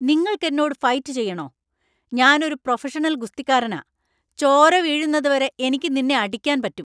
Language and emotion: Malayalam, angry